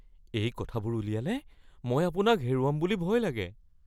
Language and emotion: Assamese, fearful